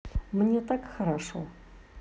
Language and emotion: Russian, positive